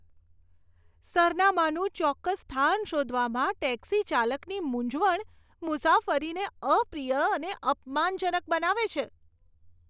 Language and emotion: Gujarati, disgusted